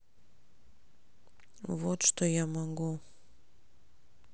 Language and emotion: Russian, sad